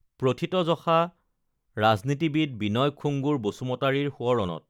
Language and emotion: Assamese, neutral